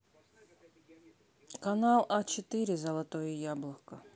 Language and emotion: Russian, neutral